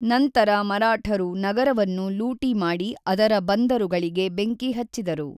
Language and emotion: Kannada, neutral